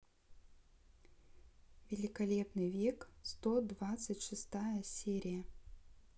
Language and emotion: Russian, neutral